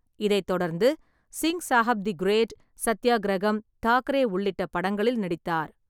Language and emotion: Tamil, neutral